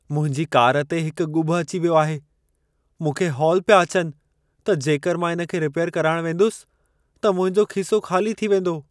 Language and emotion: Sindhi, fearful